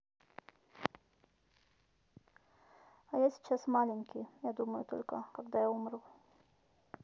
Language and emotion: Russian, neutral